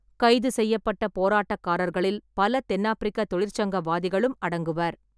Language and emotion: Tamil, neutral